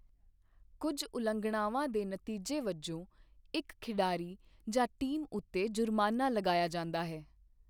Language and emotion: Punjabi, neutral